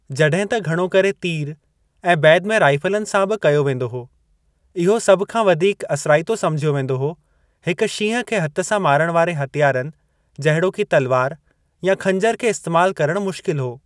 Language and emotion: Sindhi, neutral